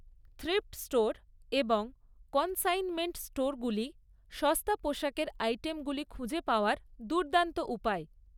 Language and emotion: Bengali, neutral